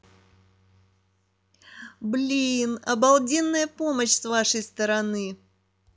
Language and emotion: Russian, positive